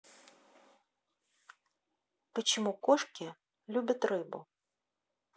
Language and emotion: Russian, neutral